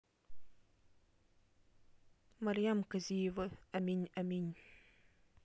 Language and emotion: Russian, neutral